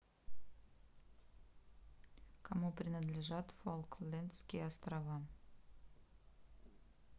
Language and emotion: Russian, neutral